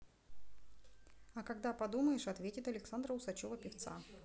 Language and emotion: Russian, neutral